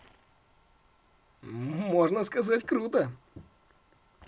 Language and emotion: Russian, positive